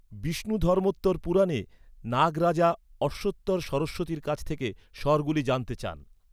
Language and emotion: Bengali, neutral